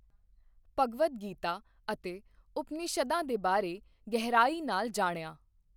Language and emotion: Punjabi, neutral